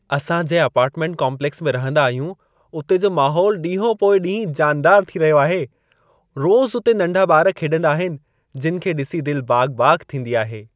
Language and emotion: Sindhi, happy